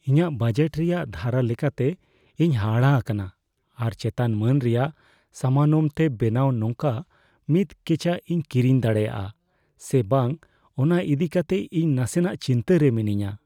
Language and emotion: Santali, fearful